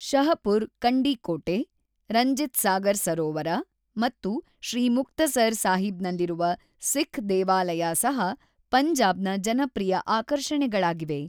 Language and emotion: Kannada, neutral